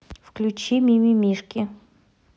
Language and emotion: Russian, neutral